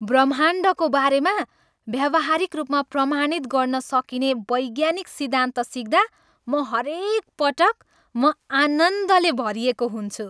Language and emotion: Nepali, happy